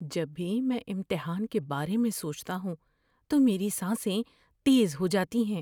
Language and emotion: Urdu, fearful